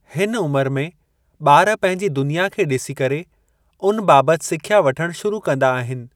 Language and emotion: Sindhi, neutral